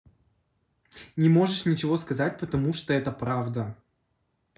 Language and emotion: Russian, angry